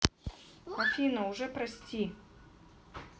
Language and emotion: Russian, sad